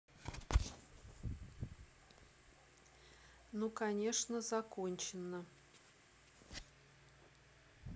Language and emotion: Russian, neutral